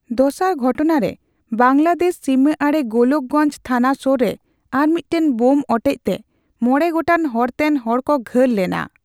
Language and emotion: Santali, neutral